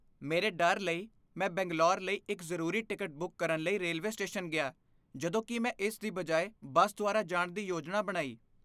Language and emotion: Punjabi, fearful